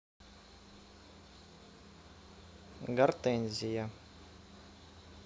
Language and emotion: Russian, neutral